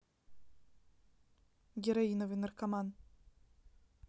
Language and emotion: Russian, neutral